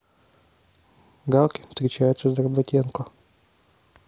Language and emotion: Russian, neutral